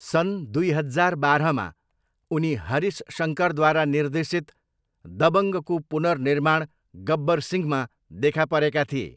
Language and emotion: Nepali, neutral